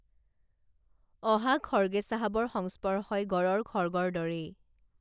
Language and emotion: Assamese, neutral